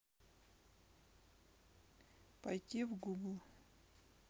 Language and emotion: Russian, neutral